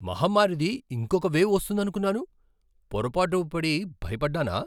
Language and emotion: Telugu, surprised